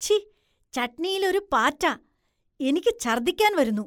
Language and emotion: Malayalam, disgusted